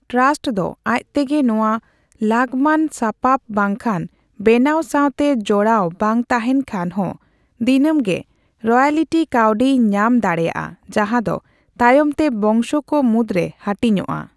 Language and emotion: Santali, neutral